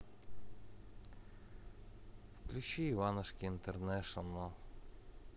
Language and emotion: Russian, neutral